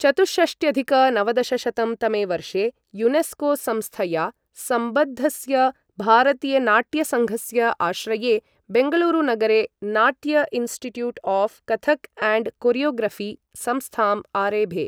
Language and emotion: Sanskrit, neutral